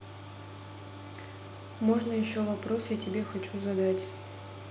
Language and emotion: Russian, neutral